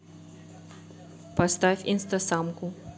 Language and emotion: Russian, neutral